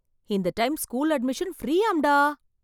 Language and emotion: Tamil, surprised